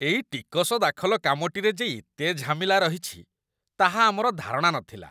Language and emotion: Odia, disgusted